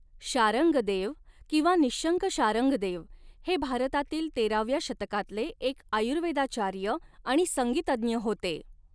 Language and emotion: Marathi, neutral